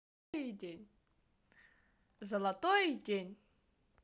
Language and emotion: Russian, neutral